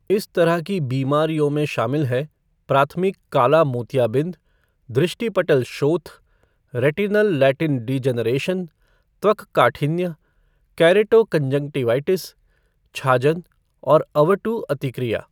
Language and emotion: Hindi, neutral